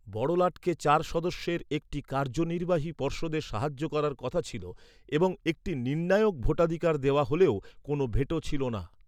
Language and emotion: Bengali, neutral